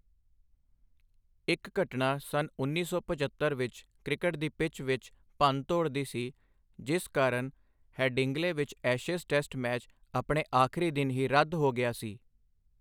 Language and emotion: Punjabi, neutral